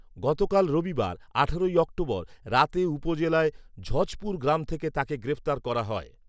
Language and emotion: Bengali, neutral